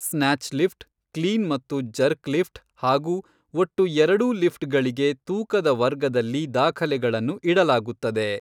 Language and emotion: Kannada, neutral